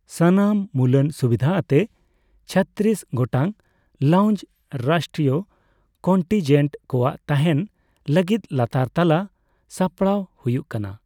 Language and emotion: Santali, neutral